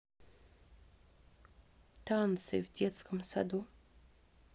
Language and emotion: Russian, neutral